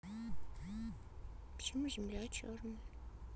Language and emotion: Russian, sad